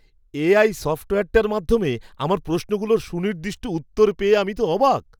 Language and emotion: Bengali, surprised